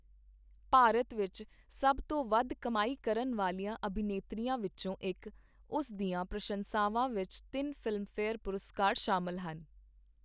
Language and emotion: Punjabi, neutral